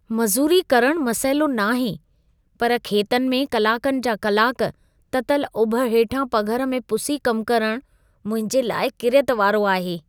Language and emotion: Sindhi, disgusted